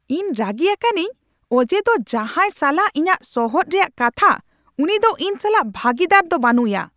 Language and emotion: Santali, angry